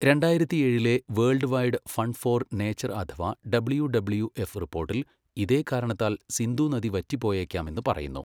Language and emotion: Malayalam, neutral